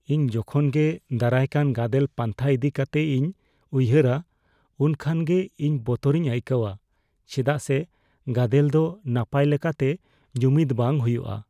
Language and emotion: Santali, fearful